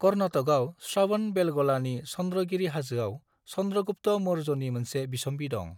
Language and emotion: Bodo, neutral